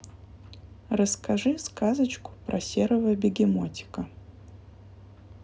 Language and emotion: Russian, neutral